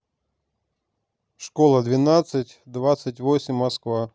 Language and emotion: Russian, neutral